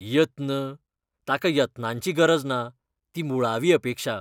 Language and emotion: Goan Konkani, disgusted